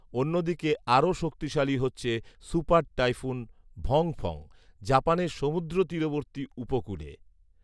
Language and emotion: Bengali, neutral